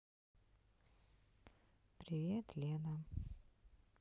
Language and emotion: Russian, sad